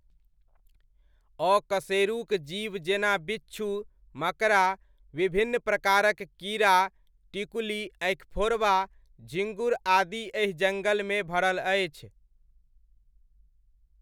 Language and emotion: Maithili, neutral